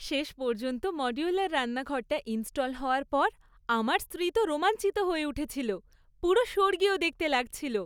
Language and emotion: Bengali, happy